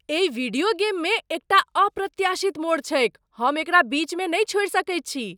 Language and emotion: Maithili, surprised